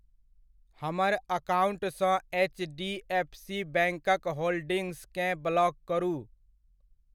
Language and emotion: Maithili, neutral